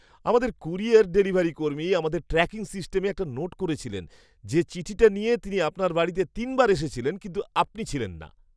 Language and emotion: Bengali, surprised